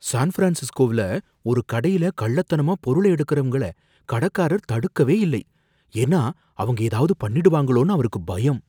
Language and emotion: Tamil, fearful